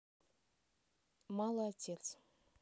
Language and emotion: Russian, neutral